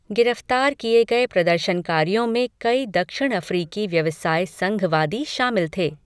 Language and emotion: Hindi, neutral